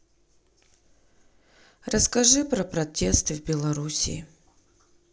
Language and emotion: Russian, sad